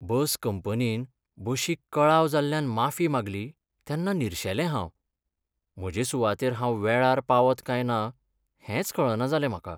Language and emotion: Goan Konkani, sad